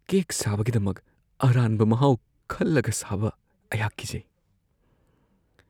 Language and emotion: Manipuri, fearful